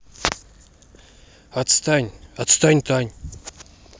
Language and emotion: Russian, angry